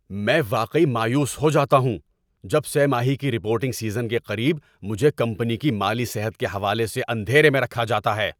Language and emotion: Urdu, angry